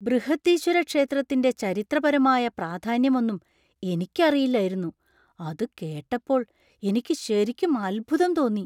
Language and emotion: Malayalam, surprised